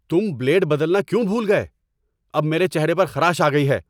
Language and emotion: Urdu, angry